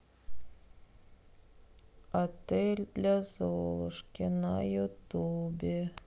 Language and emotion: Russian, sad